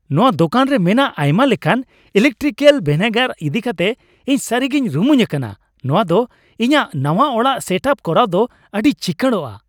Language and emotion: Santali, happy